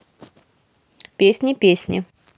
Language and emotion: Russian, positive